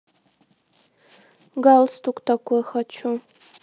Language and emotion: Russian, neutral